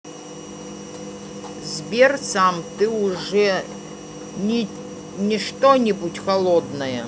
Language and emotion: Russian, neutral